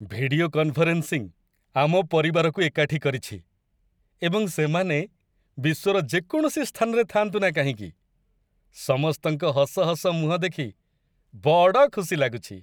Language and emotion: Odia, happy